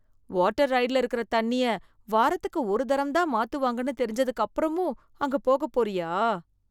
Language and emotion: Tamil, disgusted